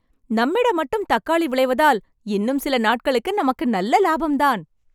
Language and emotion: Tamil, happy